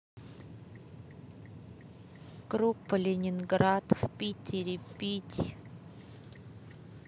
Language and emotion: Russian, neutral